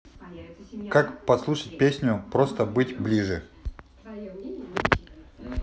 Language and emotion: Russian, neutral